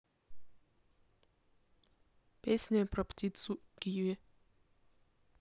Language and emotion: Russian, neutral